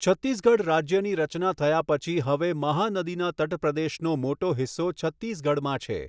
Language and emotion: Gujarati, neutral